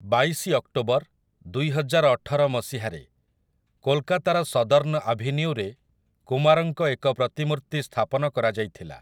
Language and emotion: Odia, neutral